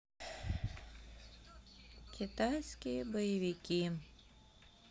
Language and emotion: Russian, sad